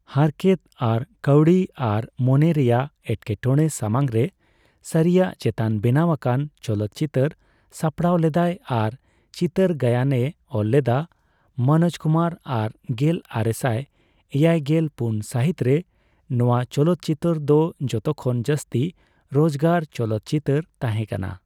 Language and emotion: Santali, neutral